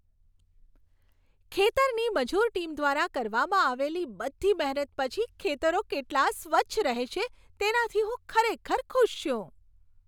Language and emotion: Gujarati, happy